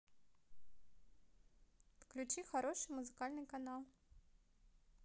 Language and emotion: Russian, neutral